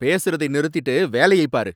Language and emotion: Tamil, angry